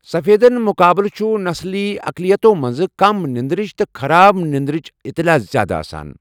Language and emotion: Kashmiri, neutral